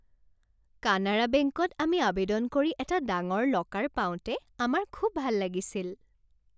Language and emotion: Assamese, happy